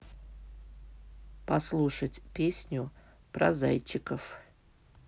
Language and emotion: Russian, neutral